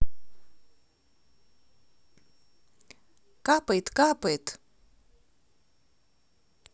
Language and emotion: Russian, positive